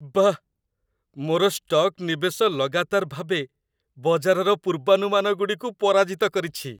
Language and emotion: Odia, happy